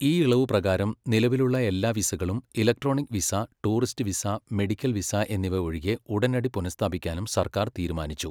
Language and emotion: Malayalam, neutral